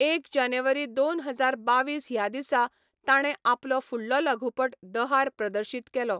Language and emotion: Goan Konkani, neutral